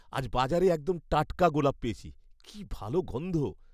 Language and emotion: Bengali, happy